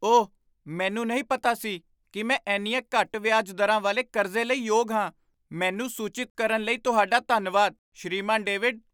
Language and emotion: Punjabi, surprised